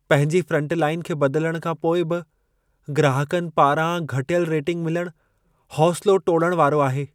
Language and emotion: Sindhi, sad